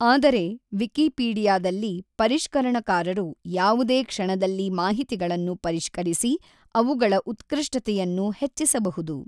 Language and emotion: Kannada, neutral